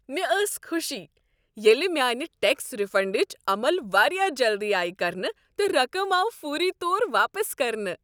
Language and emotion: Kashmiri, happy